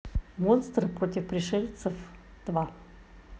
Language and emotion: Russian, neutral